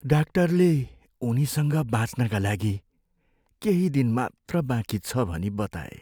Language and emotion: Nepali, sad